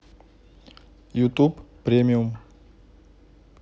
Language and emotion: Russian, neutral